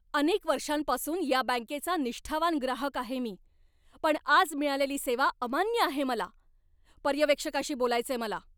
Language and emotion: Marathi, angry